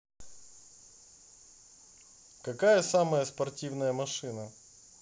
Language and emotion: Russian, neutral